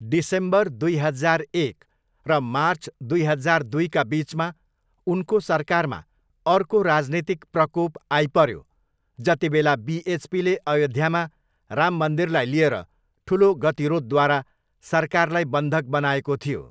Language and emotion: Nepali, neutral